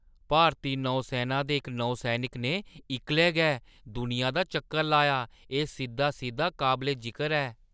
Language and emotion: Dogri, surprised